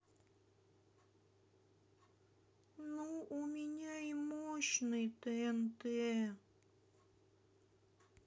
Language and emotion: Russian, sad